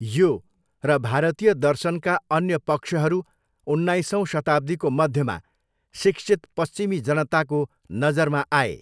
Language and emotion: Nepali, neutral